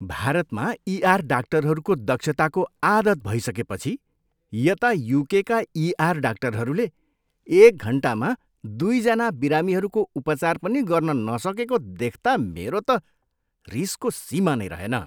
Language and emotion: Nepali, disgusted